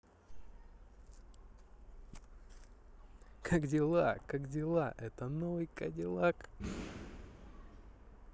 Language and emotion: Russian, positive